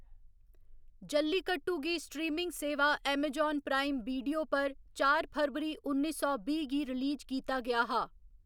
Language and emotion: Dogri, neutral